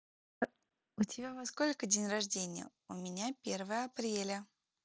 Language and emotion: Russian, positive